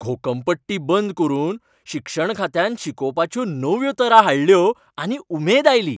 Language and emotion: Goan Konkani, happy